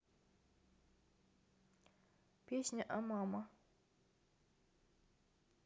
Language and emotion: Russian, neutral